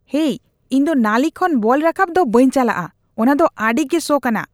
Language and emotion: Santali, disgusted